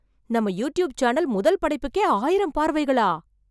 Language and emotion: Tamil, surprised